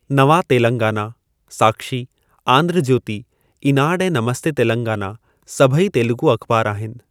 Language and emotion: Sindhi, neutral